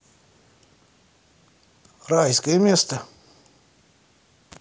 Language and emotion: Russian, neutral